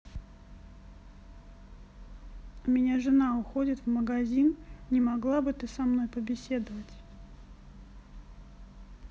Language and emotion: Russian, neutral